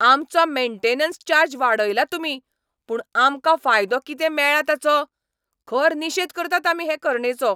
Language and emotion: Goan Konkani, angry